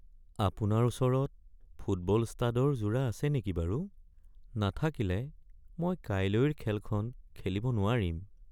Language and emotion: Assamese, sad